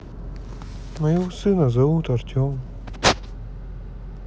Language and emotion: Russian, sad